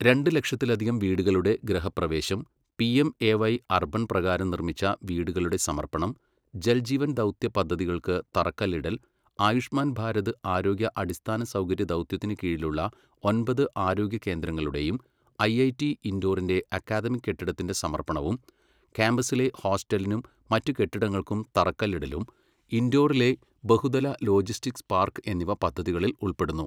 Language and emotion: Malayalam, neutral